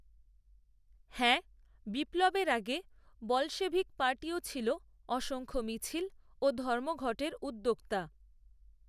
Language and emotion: Bengali, neutral